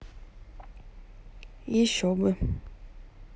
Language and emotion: Russian, neutral